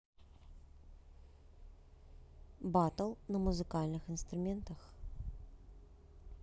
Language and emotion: Russian, neutral